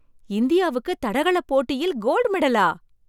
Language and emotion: Tamil, surprised